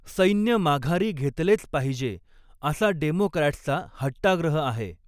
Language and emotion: Marathi, neutral